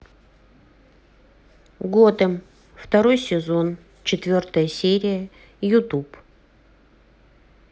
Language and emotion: Russian, neutral